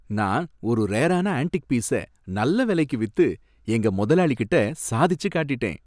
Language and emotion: Tamil, happy